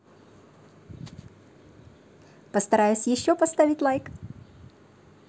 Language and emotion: Russian, positive